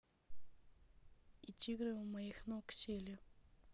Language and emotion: Russian, neutral